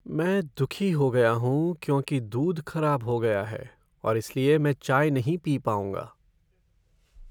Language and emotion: Hindi, sad